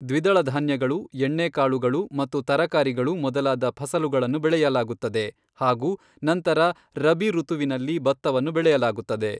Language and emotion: Kannada, neutral